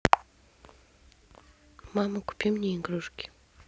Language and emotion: Russian, neutral